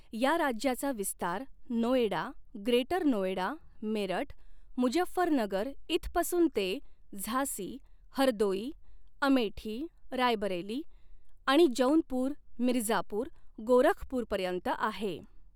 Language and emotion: Marathi, neutral